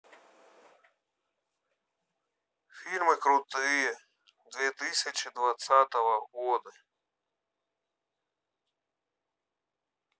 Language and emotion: Russian, neutral